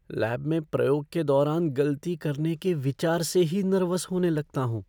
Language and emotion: Hindi, fearful